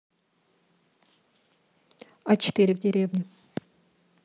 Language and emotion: Russian, neutral